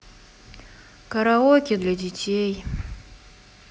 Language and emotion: Russian, sad